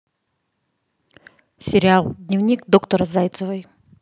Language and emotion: Russian, neutral